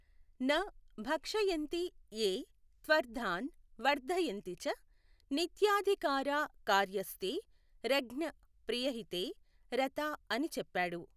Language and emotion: Telugu, neutral